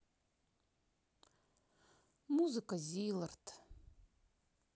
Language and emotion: Russian, sad